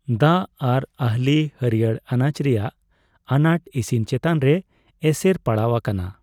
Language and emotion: Santali, neutral